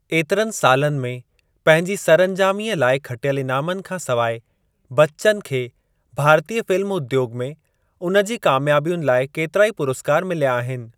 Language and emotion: Sindhi, neutral